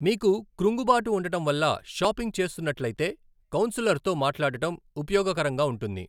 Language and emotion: Telugu, neutral